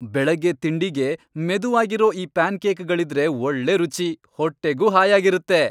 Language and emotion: Kannada, happy